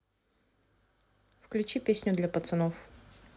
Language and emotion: Russian, neutral